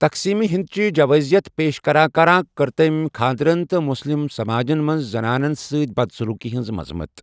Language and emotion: Kashmiri, neutral